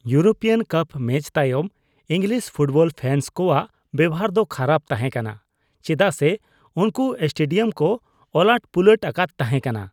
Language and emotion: Santali, disgusted